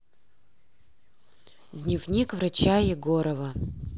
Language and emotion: Russian, neutral